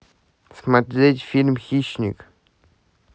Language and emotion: Russian, neutral